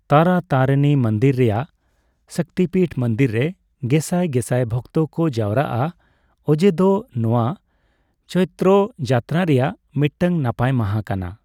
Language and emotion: Santali, neutral